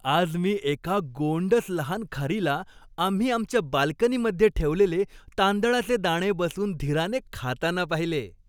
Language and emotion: Marathi, happy